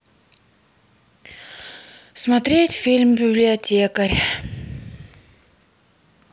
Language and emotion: Russian, sad